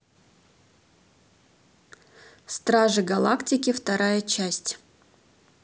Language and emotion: Russian, neutral